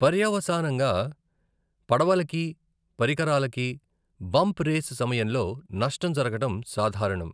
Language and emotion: Telugu, neutral